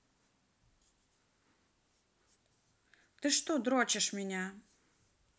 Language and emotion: Russian, neutral